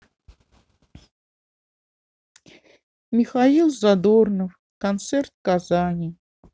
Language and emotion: Russian, sad